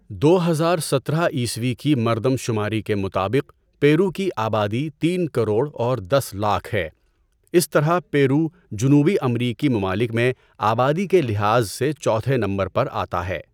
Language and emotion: Urdu, neutral